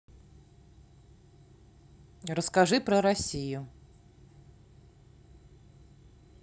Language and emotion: Russian, neutral